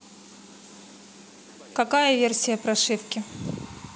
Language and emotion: Russian, neutral